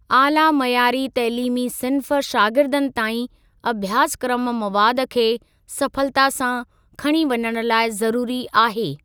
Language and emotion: Sindhi, neutral